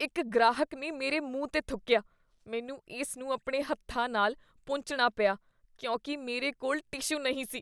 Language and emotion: Punjabi, disgusted